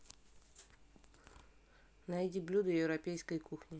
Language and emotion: Russian, neutral